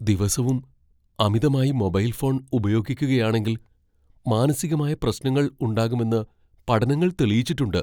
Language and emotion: Malayalam, fearful